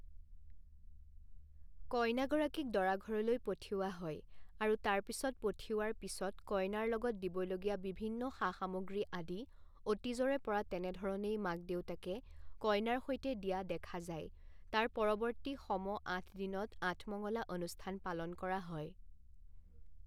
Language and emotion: Assamese, neutral